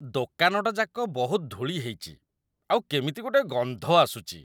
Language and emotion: Odia, disgusted